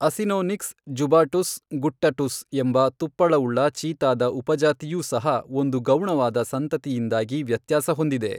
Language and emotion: Kannada, neutral